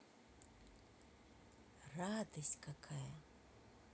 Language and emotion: Russian, positive